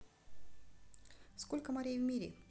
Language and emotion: Russian, neutral